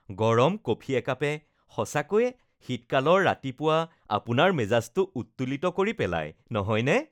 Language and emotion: Assamese, happy